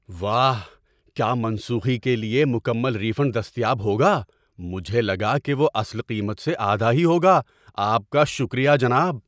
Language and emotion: Urdu, surprised